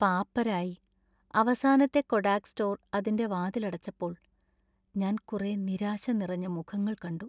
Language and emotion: Malayalam, sad